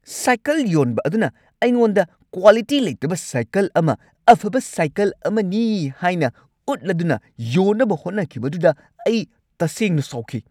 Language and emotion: Manipuri, angry